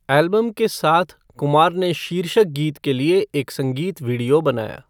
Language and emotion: Hindi, neutral